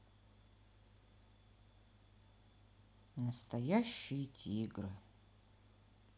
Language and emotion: Russian, neutral